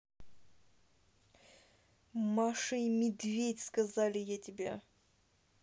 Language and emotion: Russian, angry